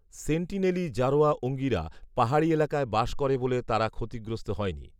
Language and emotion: Bengali, neutral